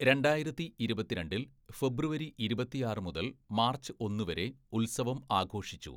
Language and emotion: Malayalam, neutral